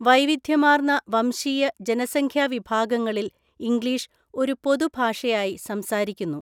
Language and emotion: Malayalam, neutral